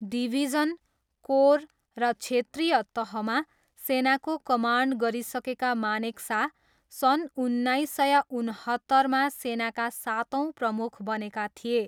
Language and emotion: Nepali, neutral